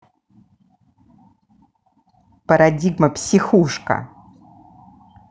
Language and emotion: Russian, angry